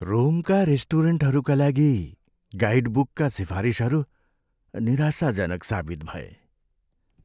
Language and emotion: Nepali, sad